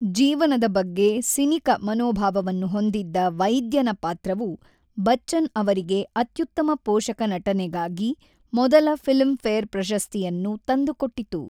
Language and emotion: Kannada, neutral